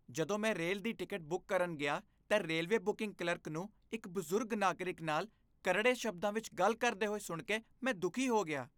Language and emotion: Punjabi, disgusted